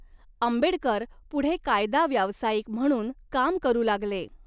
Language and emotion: Marathi, neutral